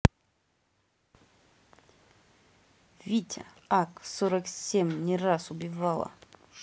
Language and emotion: Russian, neutral